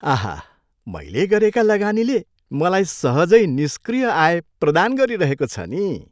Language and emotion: Nepali, happy